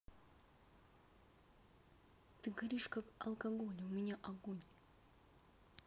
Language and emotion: Russian, neutral